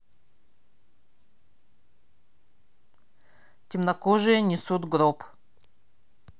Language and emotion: Russian, neutral